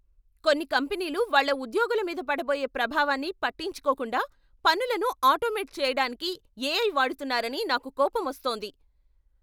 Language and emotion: Telugu, angry